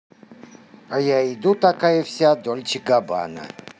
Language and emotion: Russian, positive